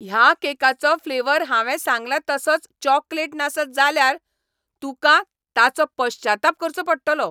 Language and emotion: Goan Konkani, angry